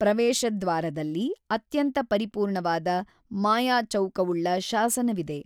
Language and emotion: Kannada, neutral